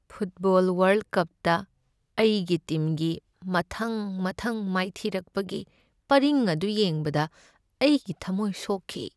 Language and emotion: Manipuri, sad